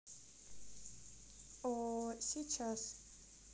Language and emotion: Russian, neutral